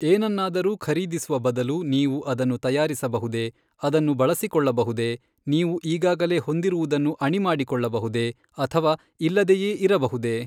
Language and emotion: Kannada, neutral